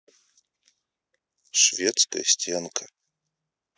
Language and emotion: Russian, neutral